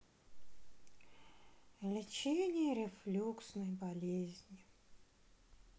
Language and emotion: Russian, sad